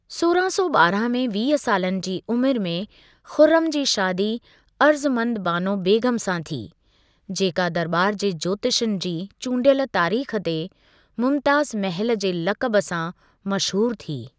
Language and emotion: Sindhi, neutral